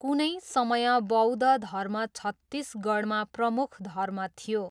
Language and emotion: Nepali, neutral